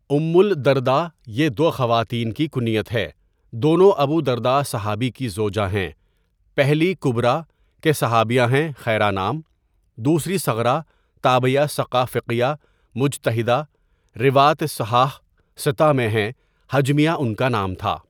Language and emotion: Urdu, neutral